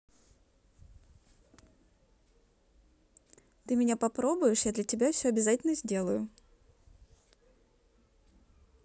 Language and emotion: Russian, neutral